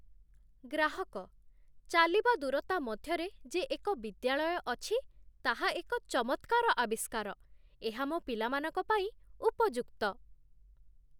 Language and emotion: Odia, surprised